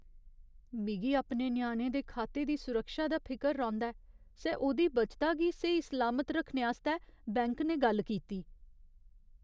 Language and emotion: Dogri, fearful